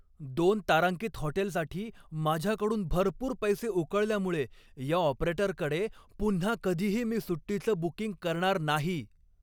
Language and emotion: Marathi, angry